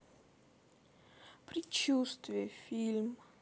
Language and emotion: Russian, sad